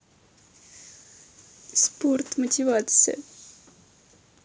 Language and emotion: Russian, neutral